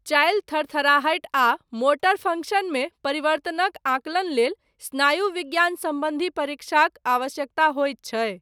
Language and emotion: Maithili, neutral